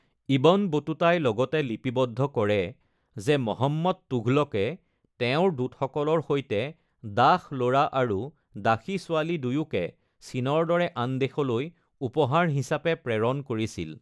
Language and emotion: Assamese, neutral